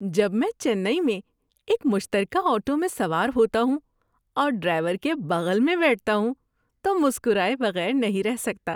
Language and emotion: Urdu, happy